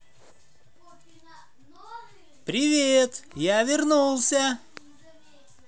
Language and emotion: Russian, positive